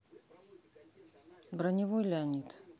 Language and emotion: Russian, neutral